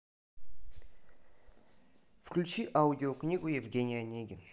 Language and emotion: Russian, neutral